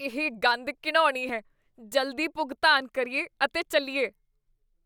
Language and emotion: Punjabi, disgusted